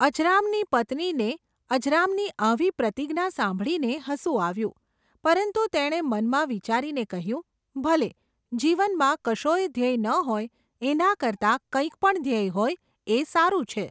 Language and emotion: Gujarati, neutral